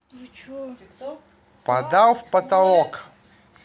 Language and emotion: Russian, neutral